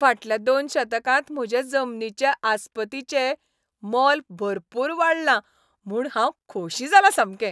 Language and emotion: Goan Konkani, happy